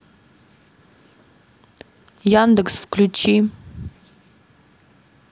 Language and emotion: Russian, neutral